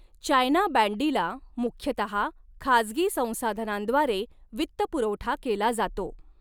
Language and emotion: Marathi, neutral